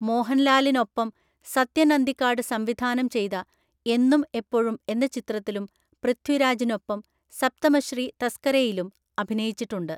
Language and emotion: Malayalam, neutral